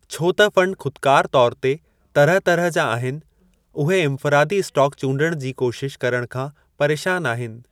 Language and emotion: Sindhi, neutral